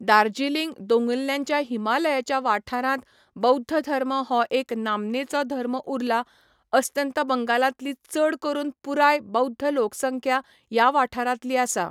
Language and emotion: Goan Konkani, neutral